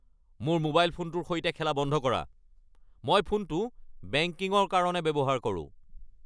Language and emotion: Assamese, angry